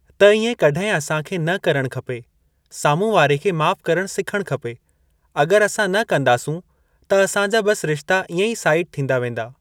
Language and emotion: Sindhi, neutral